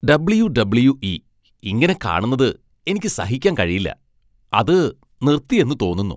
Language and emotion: Malayalam, disgusted